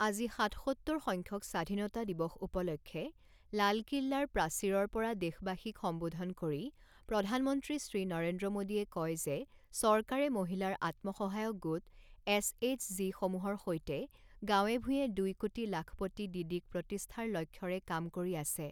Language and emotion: Assamese, neutral